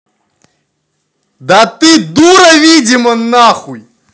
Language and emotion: Russian, angry